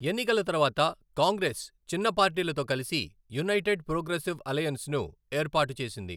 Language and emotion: Telugu, neutral